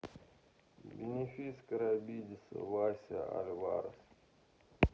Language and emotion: Russian, sad